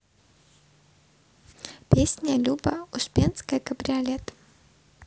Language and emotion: Russian, neutral